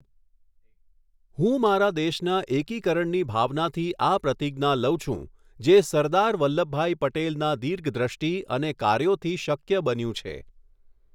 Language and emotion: Gujarati, neutral